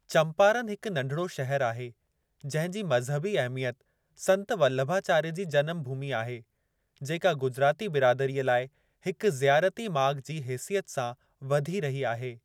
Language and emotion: Sindhi, neutral